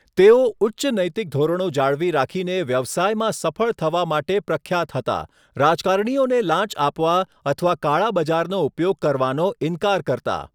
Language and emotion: Gujarati, neutral